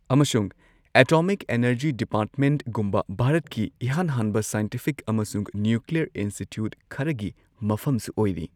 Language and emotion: Manipuri, neutral